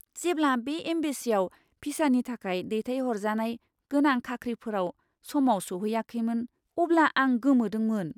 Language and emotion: Bodo, surprised